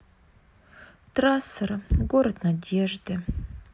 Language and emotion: Russian, sad